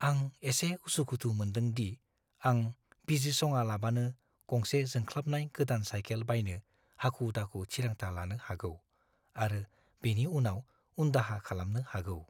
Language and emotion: Bodo, fearful